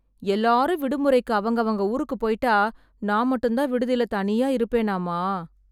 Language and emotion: Tamil, sad